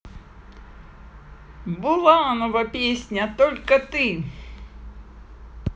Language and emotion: Russian, positive